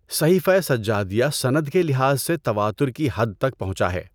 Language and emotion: Urdu, neutral